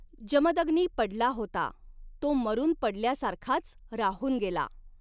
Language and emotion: Marathi, neutral